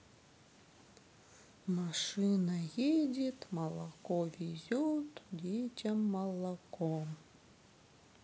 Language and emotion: Russian, sad